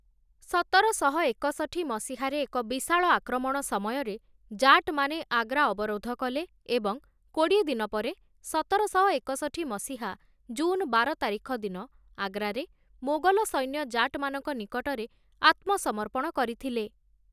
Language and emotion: Odia, neutral